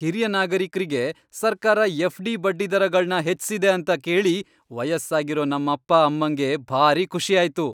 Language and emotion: Kannada, happy